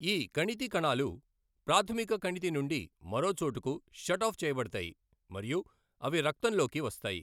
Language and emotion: Telugu, neutral